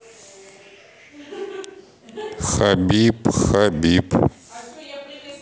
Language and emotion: Russian, neutral